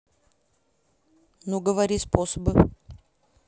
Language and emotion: Russian, neutral